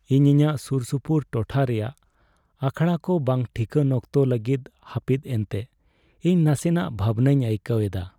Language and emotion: Santali, sad